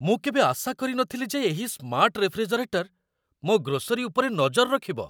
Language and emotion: Odia, surprised